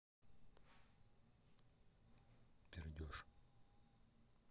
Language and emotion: Russian, neutral